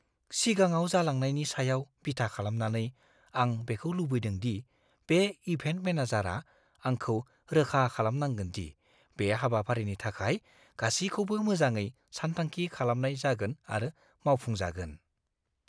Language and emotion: Bodo, fearful